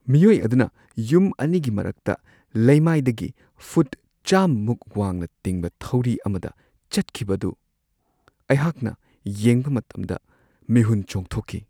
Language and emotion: Manipuri, fearful